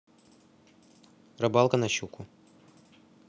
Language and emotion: Russian, neutral